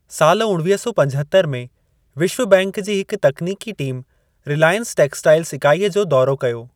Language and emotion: Sindhi, neutral